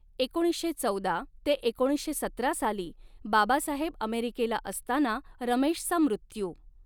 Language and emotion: Marathi, neutral